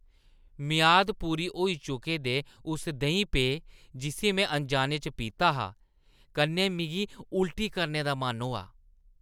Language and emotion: Dogri, disgusted